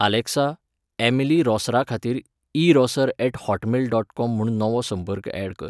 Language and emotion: Goan Konkani, neutral